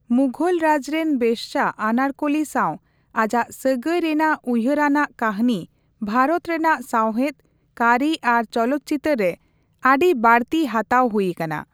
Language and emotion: Santali, neutral